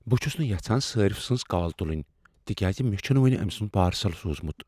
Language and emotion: Kashmiri, fearful